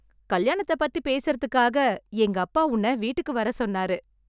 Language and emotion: Tamil, happy